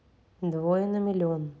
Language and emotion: Russian, neutral